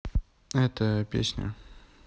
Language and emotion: Russian, neutral